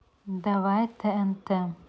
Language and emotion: Russian, neutral